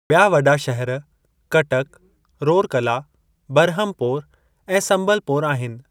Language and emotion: Sindhi, neutral